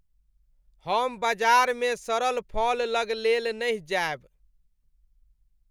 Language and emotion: Maithili, disgusted